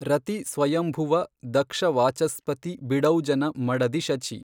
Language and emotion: Kannada, neutral